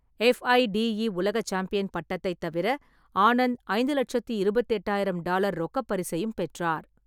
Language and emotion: Tamil, neutral